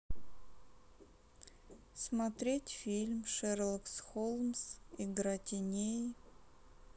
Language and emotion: Russian, sad